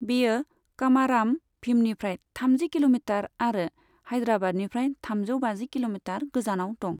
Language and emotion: Bodo, neutral